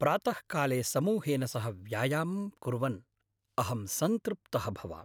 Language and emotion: Sanskrit, happy